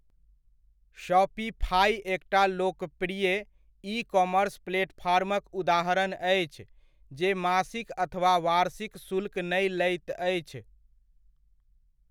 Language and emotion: Maithili, neutral